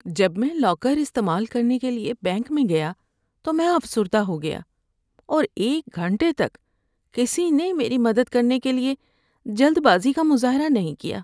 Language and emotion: Urdu, sad